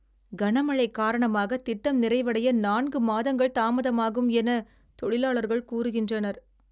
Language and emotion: Tamil, sad